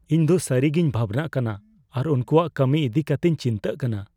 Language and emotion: Santali, fearful